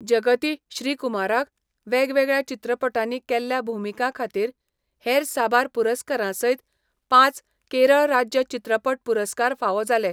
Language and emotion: Goan Konkani, neutral